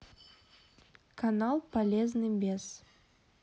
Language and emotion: Russian, neutral